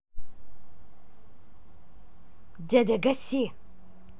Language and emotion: Russian, neutral